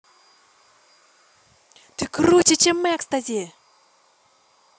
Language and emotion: Russian, positive